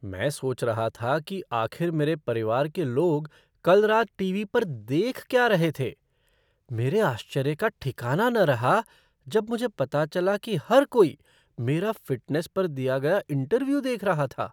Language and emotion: Hindi, surprised